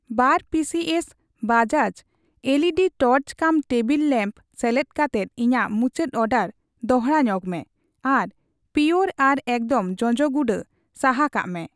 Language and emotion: Santali, neutral